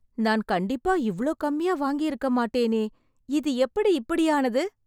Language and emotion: Tamil, surprised